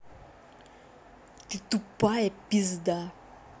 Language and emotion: Russian, angry